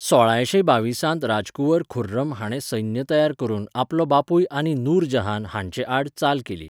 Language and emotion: Goan Konkani, neutral